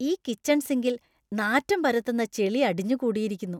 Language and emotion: Malayalam, disgusted